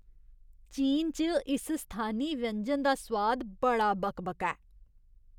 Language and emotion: Dogri, disgusted